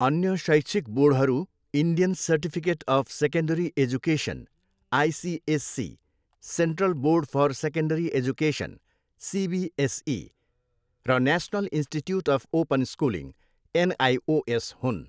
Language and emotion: Nepali, neutral